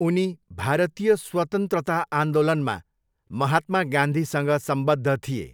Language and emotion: Nepali, neutral